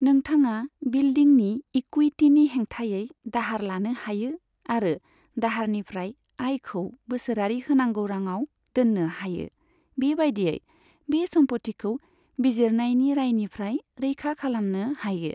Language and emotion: Bodo, neutral